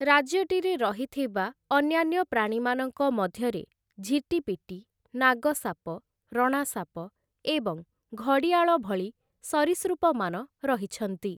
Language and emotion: Odia, neutral